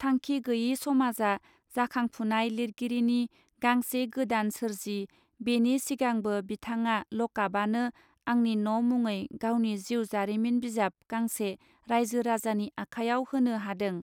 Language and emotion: Bodo, neutral